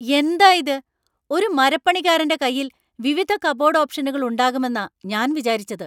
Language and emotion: Malayalam, angry